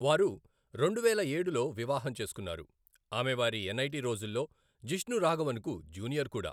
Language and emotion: Telugu, neutral